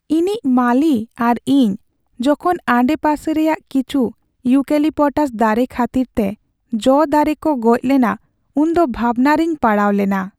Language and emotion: Santali, sad